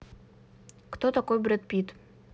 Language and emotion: Russian, neutral